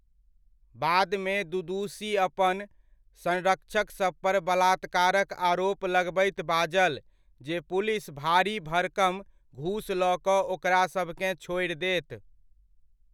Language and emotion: Maithili, neutral